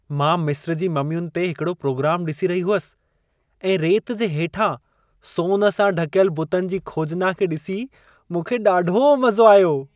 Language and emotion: Sindhi, happy